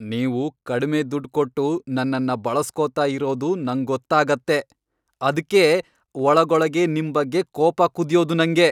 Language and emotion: Kannada, angry